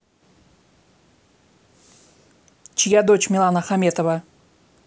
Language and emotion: Russian, neutral